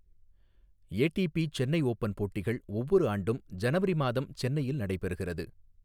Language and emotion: Tamil, neutral